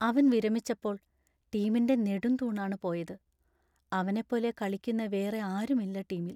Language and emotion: Malayalam, sad